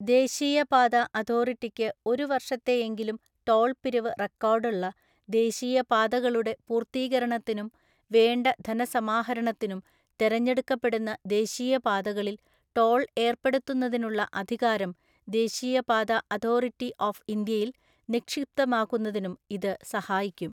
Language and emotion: Malayalam, neutral